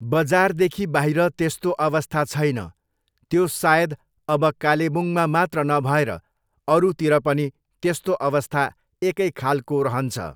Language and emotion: Nepali, neutral